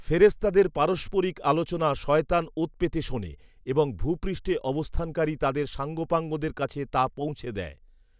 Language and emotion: Bengali, neutral